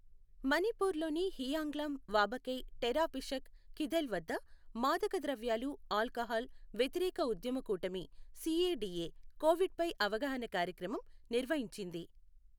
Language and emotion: Telugu, neutral